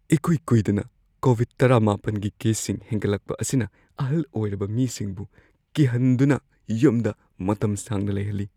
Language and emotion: Manipuri, fearful